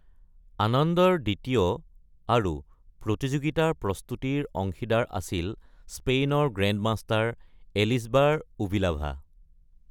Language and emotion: Assamese, neutral